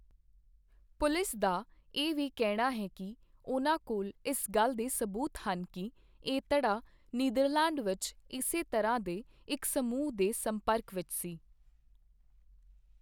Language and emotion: Punjabi, neutral